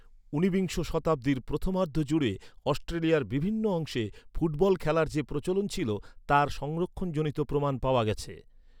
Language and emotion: Bengali, neutral